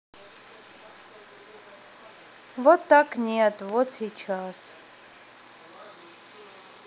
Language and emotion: Russian, sad